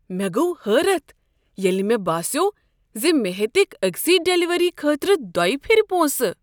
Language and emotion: Kashmiri, surprised